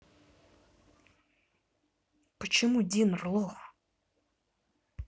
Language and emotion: Russian, neutral